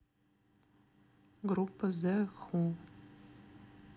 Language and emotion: Russian, sad